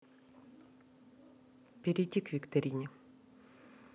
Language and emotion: Russian, neutral